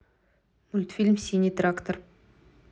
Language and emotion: Russian, neutral